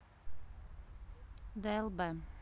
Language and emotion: Russian, neutral